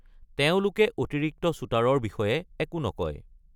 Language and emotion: Assamese, neutral